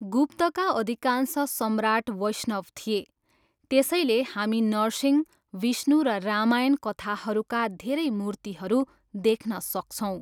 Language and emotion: Nepali, neutral